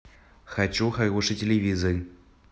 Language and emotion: Russian, neutral